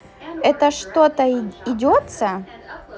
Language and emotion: Russian, positive